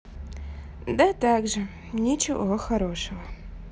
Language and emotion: Russian, sad